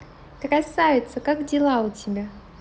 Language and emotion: Russian, positive